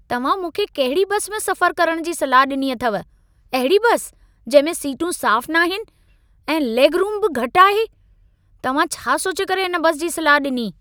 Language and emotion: Sindhi, angry